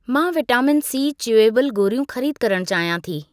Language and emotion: Sindhi, neutral